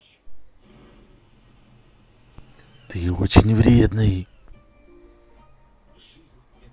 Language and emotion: Russian, angry